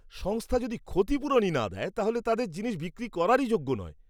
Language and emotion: Bengali, disgusted